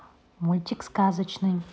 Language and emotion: Russian, neutral